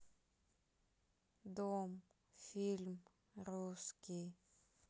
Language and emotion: Russian, sad